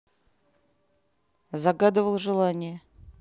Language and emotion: Russian, neutral